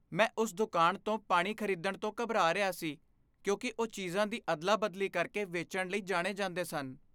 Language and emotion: Punjabi, fearful